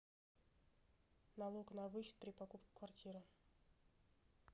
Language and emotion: Russian, neutral